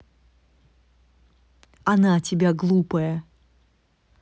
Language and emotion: Russian, neutral